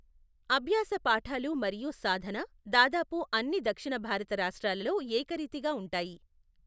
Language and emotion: Telugu, neutral